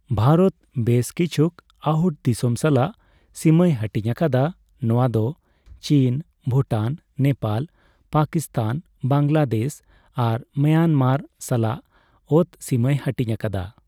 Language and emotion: Santali, neutral